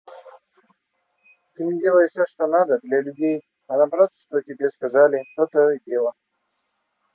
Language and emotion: Russian, neutral